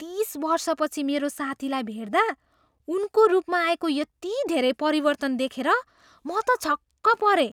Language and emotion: Nepali, surprised